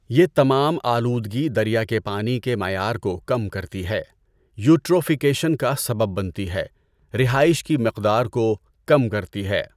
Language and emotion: Urdu, neutral